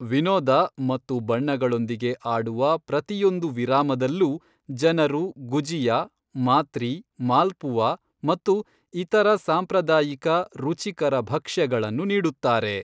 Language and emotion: Kannada, neutral